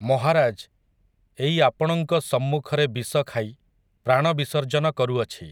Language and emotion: Odia, neutral